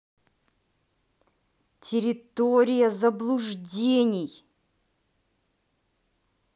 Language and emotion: Russian, angry